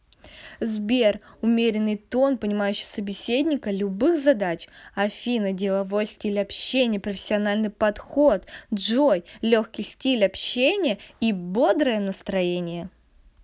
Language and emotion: Russian, positive